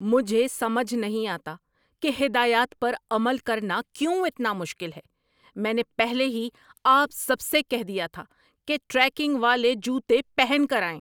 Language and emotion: Urdu, angry